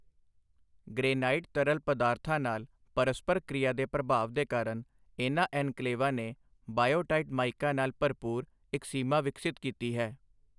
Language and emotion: Punjabi, neutral